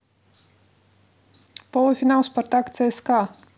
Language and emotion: Russian, neutral